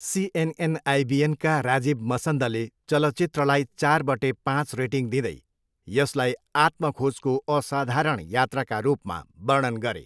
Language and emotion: Nepali, neutral